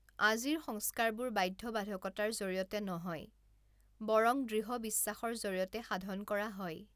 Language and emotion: Assamese, neutral